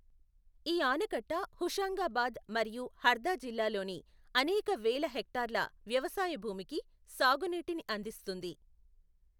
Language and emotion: Telugu, neutral